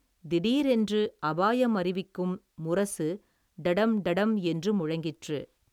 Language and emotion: Tamil, neutral